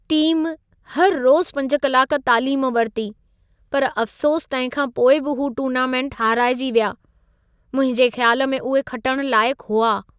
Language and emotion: Sindhi, sad